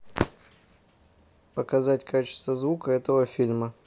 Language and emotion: Russian, neutral